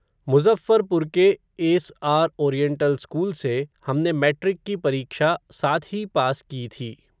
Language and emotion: Hindi, neutral